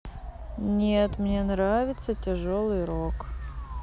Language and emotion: Russian, neutral